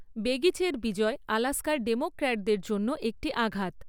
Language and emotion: Bengali, neutral